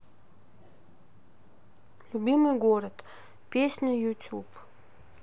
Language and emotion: Russian, neutral